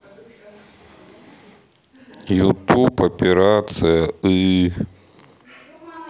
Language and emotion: Russian, sad